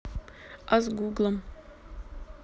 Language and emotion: Russian, neutral